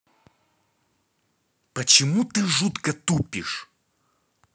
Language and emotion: Russian, angry